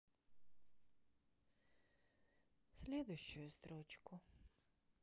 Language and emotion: Russian, sad